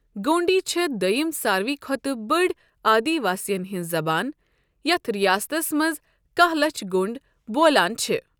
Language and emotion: Kashmiri, neutral